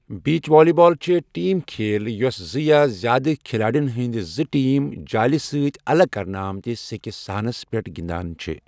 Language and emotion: Kashmiri, neutral